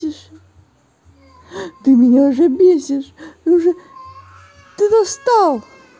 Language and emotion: Russian, angry